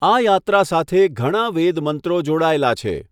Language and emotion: Gujarati, neutral